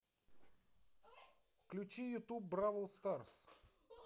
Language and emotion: Russian, positive